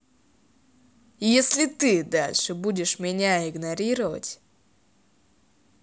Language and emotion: Russian, angry